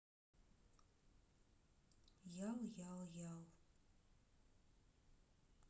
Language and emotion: Russian, sad